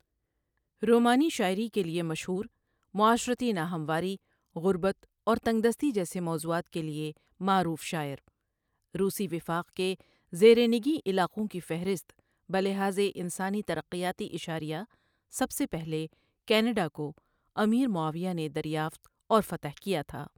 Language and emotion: Urdu, neutral